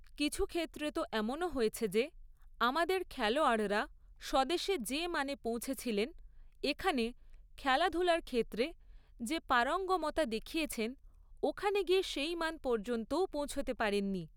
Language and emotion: Bengali, neutral